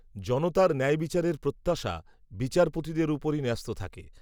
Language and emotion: Bengali, neutral